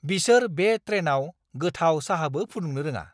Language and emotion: Bodo, angry